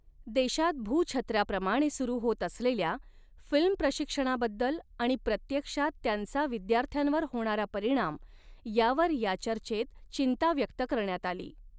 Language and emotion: Marathi, neutral